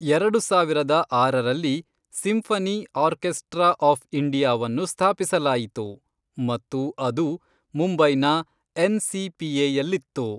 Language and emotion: Kannada, neutral